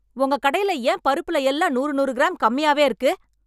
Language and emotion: Tamil, angry